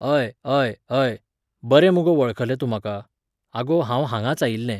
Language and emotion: Goan Konkani, neutral